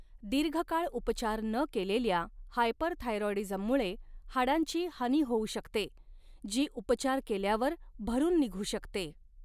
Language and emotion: Marathi, neutral